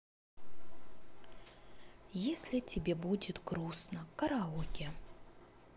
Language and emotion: Russian, sad